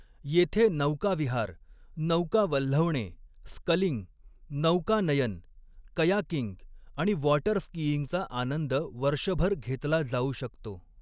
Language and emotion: Marathi, neutral